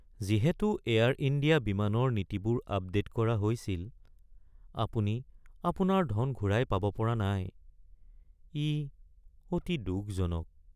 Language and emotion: Assamese, sad